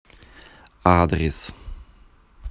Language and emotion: Russian, neutral